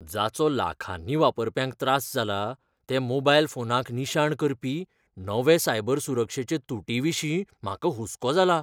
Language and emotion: Goan Konkani, fearful